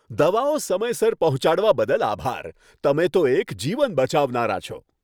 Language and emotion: Gujarati, happy